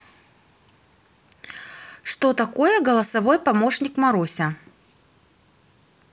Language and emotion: Russian, neutral